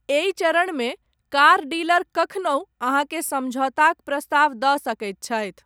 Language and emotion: Maithili, neutral